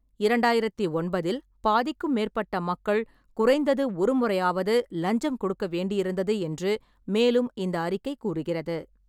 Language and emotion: Tamil, neutral